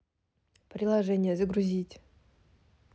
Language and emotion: Russian, neutral